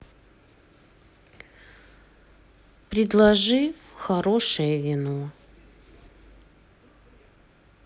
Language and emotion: Russian, sad